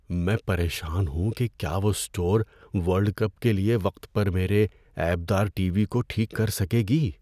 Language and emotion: Urdu, fearful